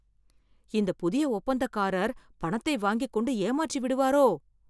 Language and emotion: Tamil, fearful